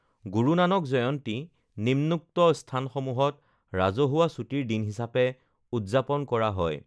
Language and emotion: Assamese, neutral